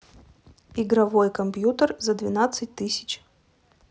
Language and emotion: Russian, neutral